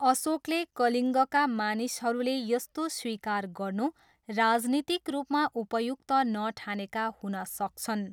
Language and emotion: Nepali, neutral